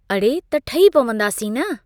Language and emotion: Sindhi, neutral